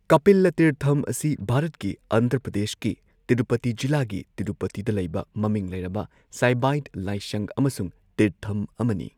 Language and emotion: Manipuri, neutral